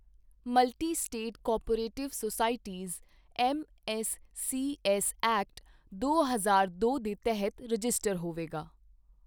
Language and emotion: Punjabi, neutral